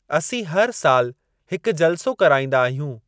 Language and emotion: Sindhi, neutral